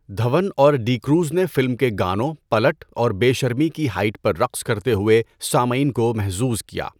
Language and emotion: Urdu, neutral